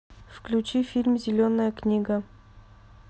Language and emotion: Russian, neutral